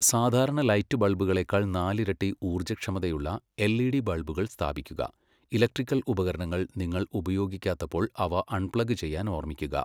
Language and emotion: Malayalam, neutral